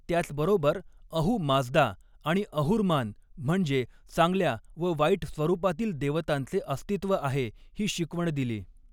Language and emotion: Marathi, neutral